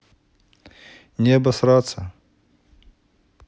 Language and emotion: Russian, neutral